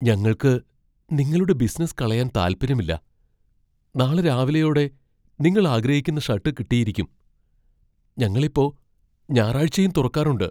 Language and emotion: Malayalam, fearful